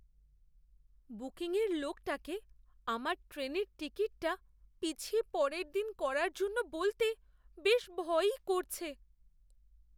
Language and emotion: Bengali, fearful